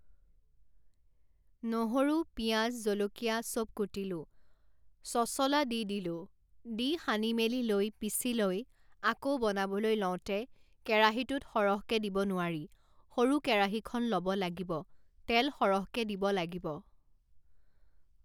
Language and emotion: Assamese, neutral